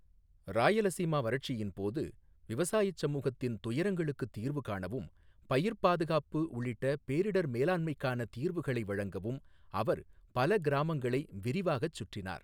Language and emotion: Tamil, neutral